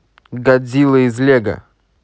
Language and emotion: Russian, neutral